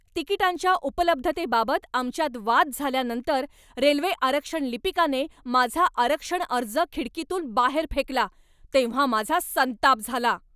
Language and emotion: Marathi, angry